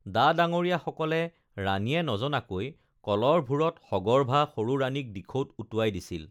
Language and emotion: Assamese, neutral